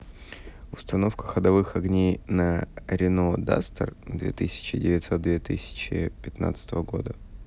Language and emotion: Russian, neutral